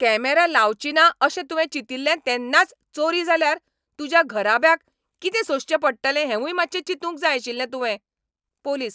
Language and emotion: Goan Konkani, angry